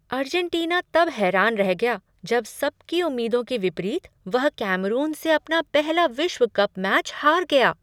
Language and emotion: Hindi, surprised